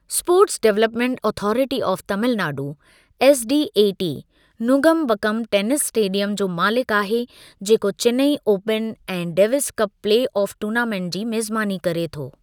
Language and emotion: Sindhi, neutral